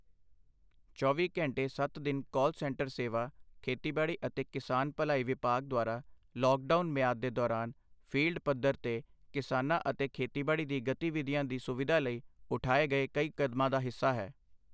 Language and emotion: Punjabi, neutral